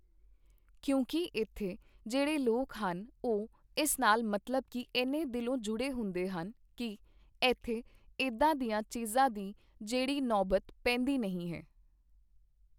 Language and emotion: Punjabi, neutral